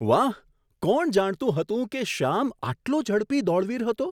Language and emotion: Gujarati, surprised